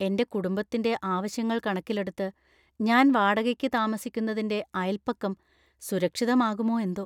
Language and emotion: Malayalam, fearful